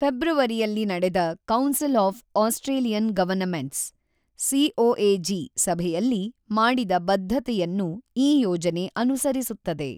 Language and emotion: Kannada, neutral